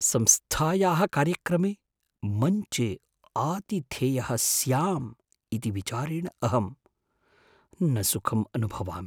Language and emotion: Sanskrit, fearful